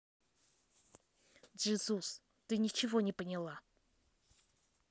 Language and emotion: Russian, angry